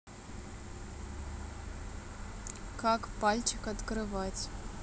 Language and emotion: Russian, neutral